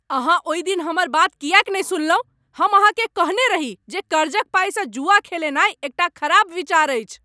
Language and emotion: Maithili, angry